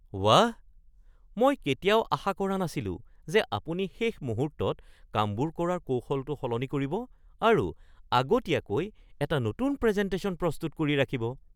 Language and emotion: Assamese, surprised